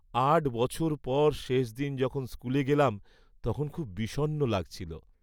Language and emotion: Bengali, sad